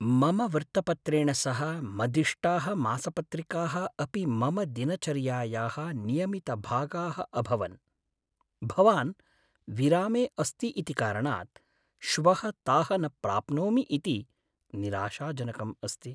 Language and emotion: Sanskrit, sad